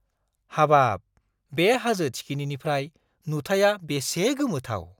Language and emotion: Bodo, surprised